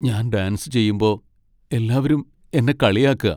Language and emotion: Malayalam, sad